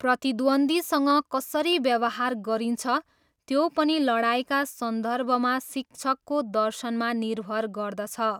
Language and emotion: Nepali, neutral